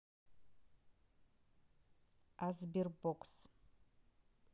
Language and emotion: Russian, neutral